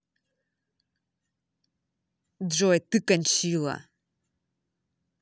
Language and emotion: Russian, angry